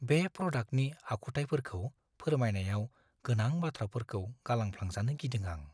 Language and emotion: Bodo, fearful